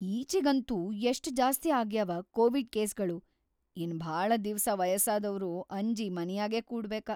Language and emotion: Kannada, fearful